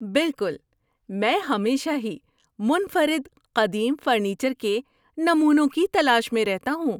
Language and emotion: Urdu, happy